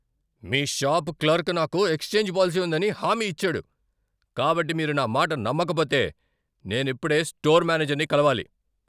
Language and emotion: Telugu, angry